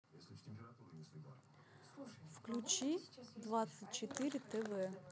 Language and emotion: Russian, neutral